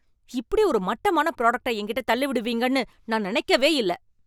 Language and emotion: Tamil, angry